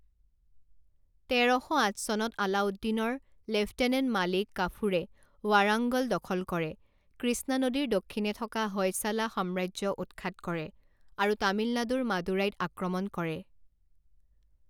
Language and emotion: Assamese, neutral